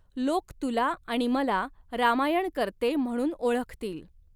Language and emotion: Marathi, neutral